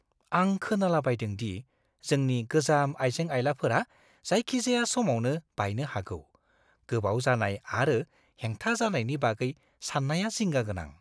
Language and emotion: Bodo, fearful